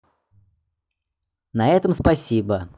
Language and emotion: Russian, positive